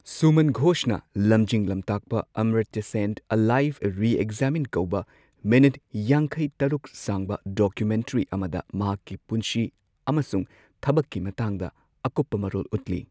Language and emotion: Manipuri, neutral